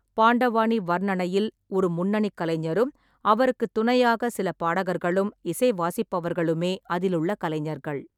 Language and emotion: Tamil, neutral